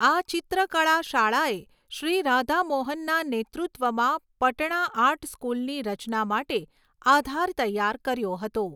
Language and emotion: Gujarati, neutral